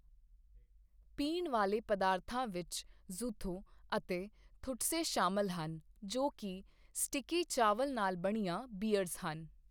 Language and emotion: Punjabi, neutral